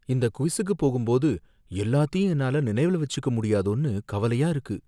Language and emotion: Tamil, fearful